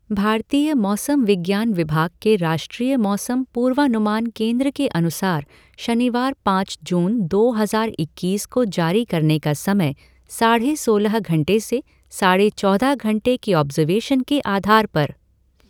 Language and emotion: Hindi, neutral